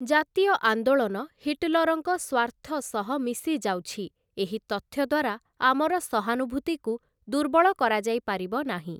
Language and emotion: Odia, neutral